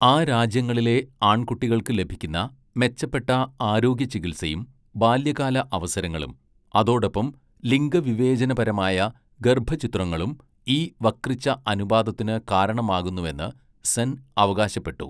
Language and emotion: Malayalam, neutral